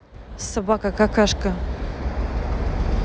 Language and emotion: Russian, angry